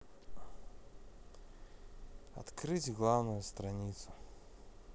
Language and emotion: Russian, neutral